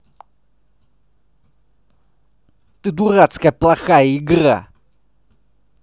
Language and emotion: Russian, angry